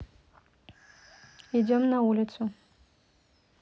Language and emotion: Russian, neutral